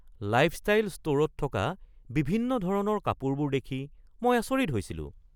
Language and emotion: Assamese, surprised